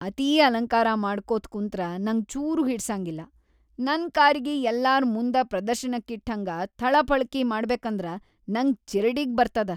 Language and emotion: Kannada, disgusted